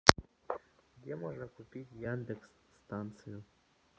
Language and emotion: Russian, neutral